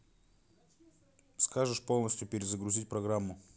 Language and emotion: Russian, neutral